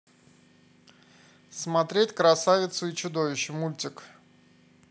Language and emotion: Russian, neutral